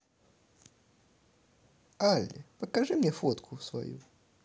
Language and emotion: Russian, positive